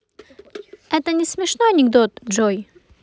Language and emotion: Russian, neutral